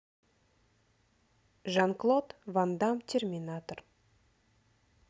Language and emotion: Russian, neutral